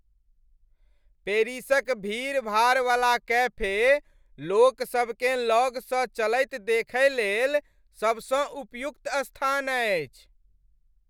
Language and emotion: Maithili, happy